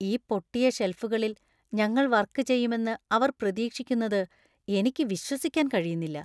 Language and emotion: Malayalam, disgusted